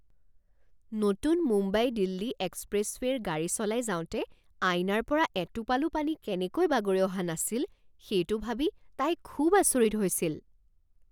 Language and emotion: Assamese, surprised